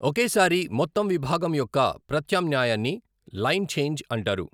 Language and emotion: Telugu, neutral